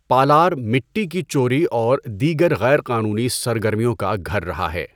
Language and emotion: Urdu, neutral